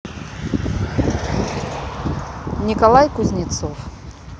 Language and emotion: Russian, neutral